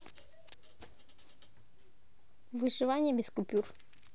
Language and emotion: Russian, neutral